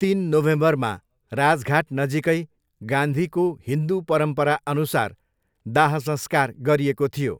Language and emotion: Nepali, neutral